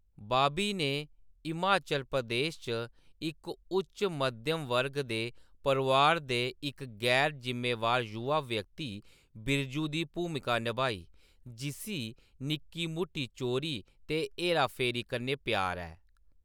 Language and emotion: Dogri, neutral